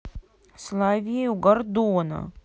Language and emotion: Russian, sad